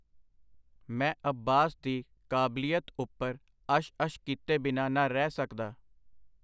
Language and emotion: Punjabi, neutral